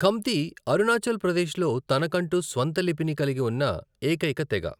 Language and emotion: Telugu, neutral